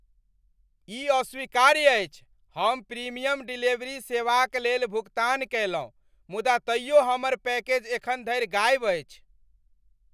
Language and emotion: Maithili, angry